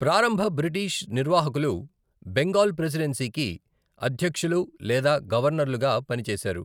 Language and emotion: Telugu, neutral